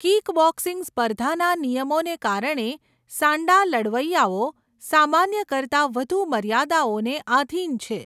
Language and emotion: Gujarati, neutral